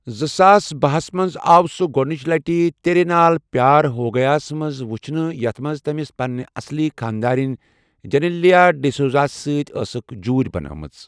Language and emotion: Kashmiri, neutral